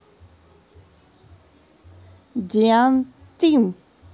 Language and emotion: Russian, neutral